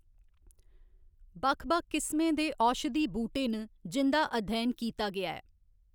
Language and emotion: Dogri, neutral